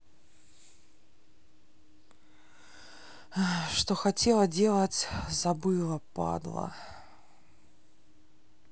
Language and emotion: Russian, sad